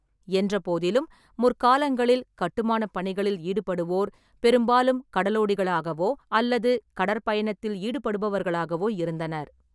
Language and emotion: Tamil, neutral